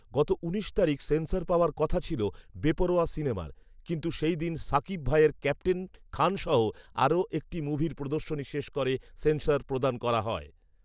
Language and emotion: Bengali, neutral